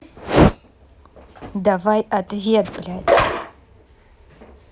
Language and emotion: Russian, angry